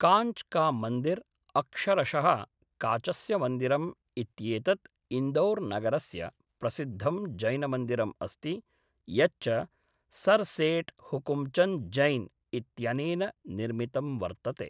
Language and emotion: Sanskrit, neutral